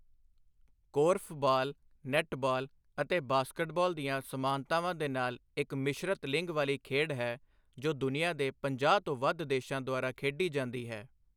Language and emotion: Punjabi, neutral